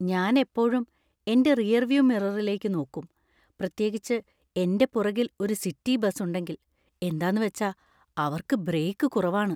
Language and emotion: Malayalam, fearful